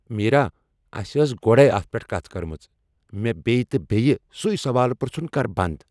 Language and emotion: Kashmiri, angry